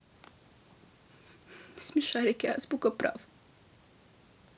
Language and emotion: Russian, sad